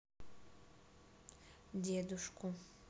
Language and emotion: Russian, sad